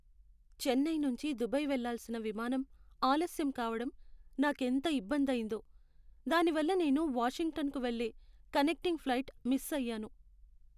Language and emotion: Telugu, sad